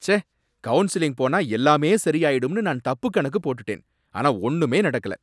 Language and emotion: Tamil, angry